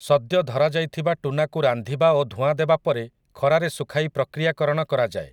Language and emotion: Odia, neutral